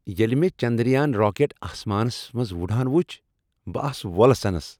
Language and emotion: Kashmiri, happy